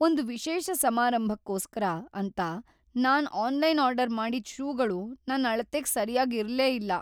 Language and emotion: Kannada, sad